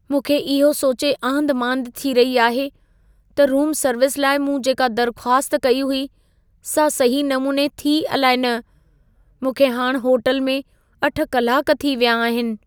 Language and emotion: Sindhi, fearful